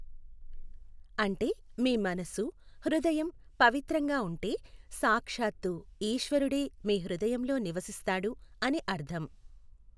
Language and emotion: Telugu, neutral